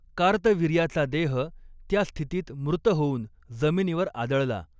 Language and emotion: Marathi, neutral